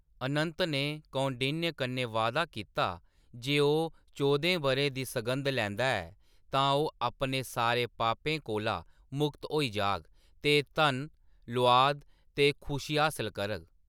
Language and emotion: Dogri, neutral